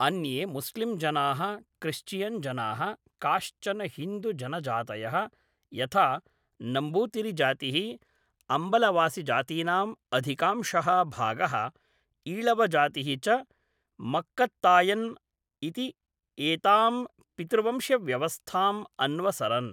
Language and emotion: Sanskrit, neutral